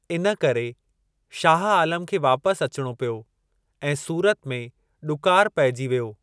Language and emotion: Sindhi, neutral